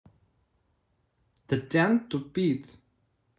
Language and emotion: Russian, neutral